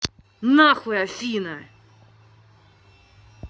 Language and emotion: Russian, angry